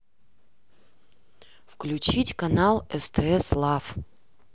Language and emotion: Russian, neutral